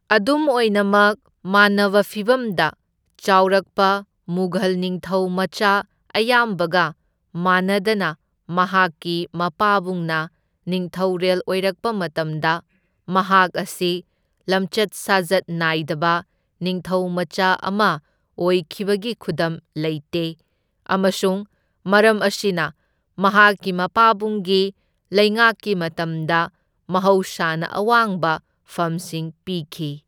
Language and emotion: Manipuri, neutral